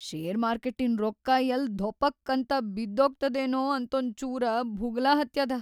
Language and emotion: Kannada, fearful